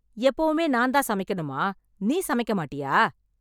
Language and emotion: Tamil, angry